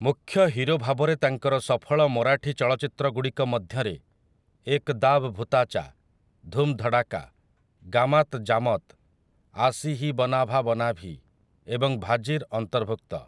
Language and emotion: Odia, neutral